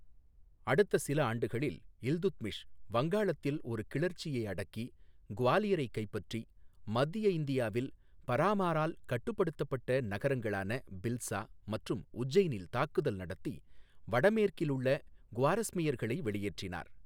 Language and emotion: Tamil, neutral